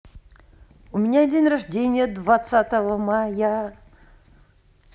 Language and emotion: Russian, positive